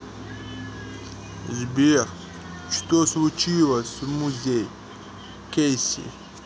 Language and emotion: Russian, neutral